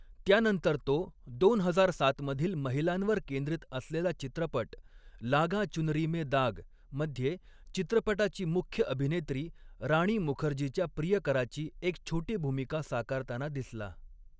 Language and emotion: Marathi, neutral